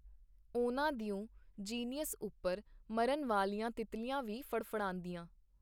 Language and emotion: Punjabi, neutral